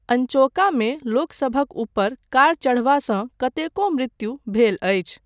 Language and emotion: Maithili, neutral